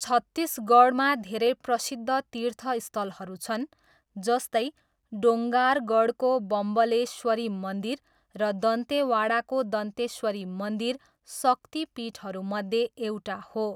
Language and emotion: Nepali, neutral